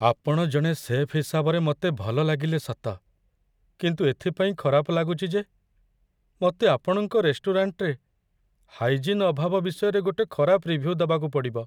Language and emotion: Odia, sad